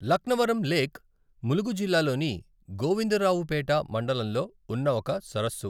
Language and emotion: Telugu, neutral